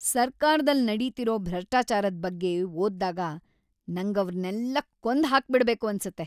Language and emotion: Kannada, angry